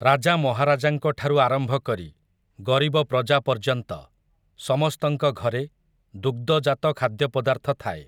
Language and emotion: Odia, neutral